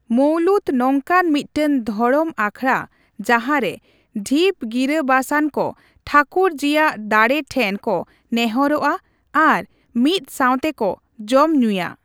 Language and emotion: Santali, neutral